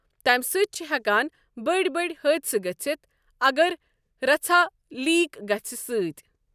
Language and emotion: Kashmiri, neutral